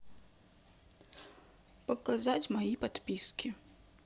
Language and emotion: Russian, sad